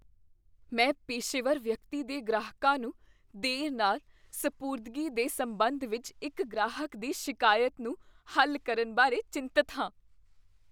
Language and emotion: Punjabi, fearful